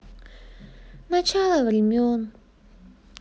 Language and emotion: Russian, sad